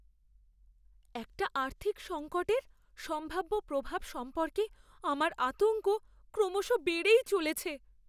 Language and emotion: Bengali, fearful